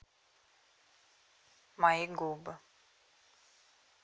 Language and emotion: Russian, neutral